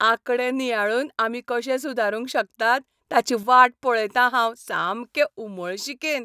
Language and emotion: Goan Konkani, happy